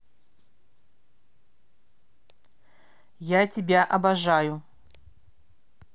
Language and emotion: Russian, angry